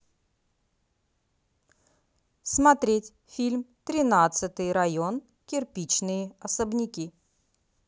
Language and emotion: Russian, neutral